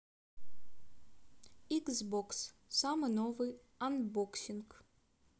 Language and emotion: Russian, neutral